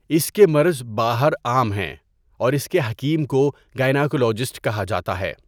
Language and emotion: Urdu, neutral